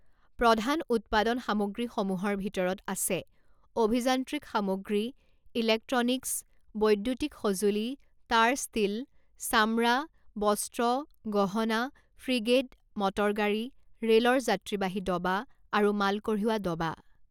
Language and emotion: Assamese, neutral